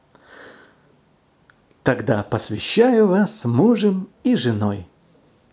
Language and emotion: Russian, positive